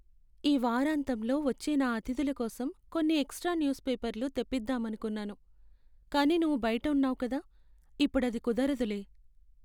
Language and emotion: Telugu, sad